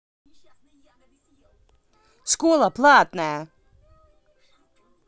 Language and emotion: Russian, angry